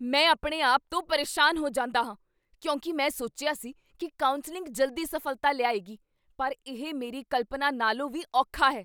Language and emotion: Punjabi, angry